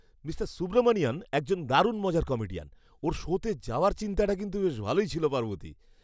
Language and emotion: Bengali, happy